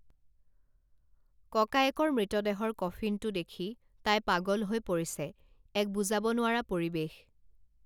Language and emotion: Assamese, neutral